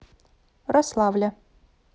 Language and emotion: Russian, neutral